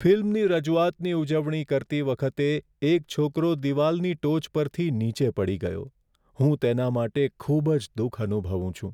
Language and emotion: Gujarati, sad